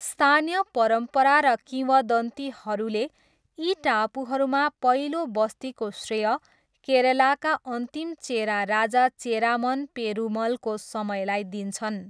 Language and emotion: Nepali, neutral